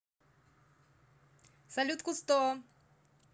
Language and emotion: Russian, positive